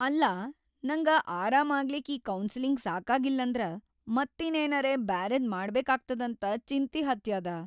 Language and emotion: Kannada, fearful